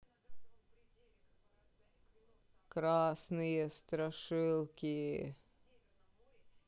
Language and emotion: Russian, neutral